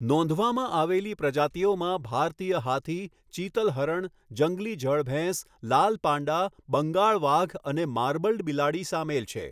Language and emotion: Gujarati, neutral